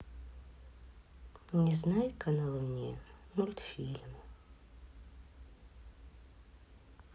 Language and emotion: Russian, sad